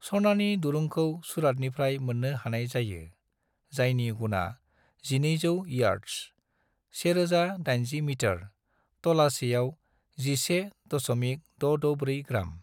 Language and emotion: Bodo, neutral